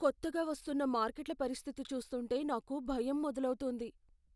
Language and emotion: Telugu, fearful